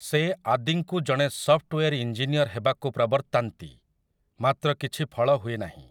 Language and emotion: Odia, neutral